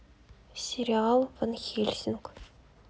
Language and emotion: Russian, neutral